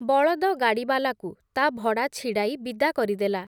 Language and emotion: Odia, neutral